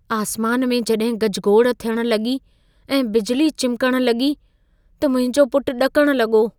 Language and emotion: Sindhi, fearful